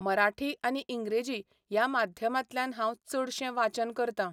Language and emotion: Goan Konkani, neutral